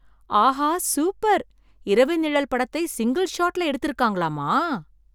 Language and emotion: Tamil, surprised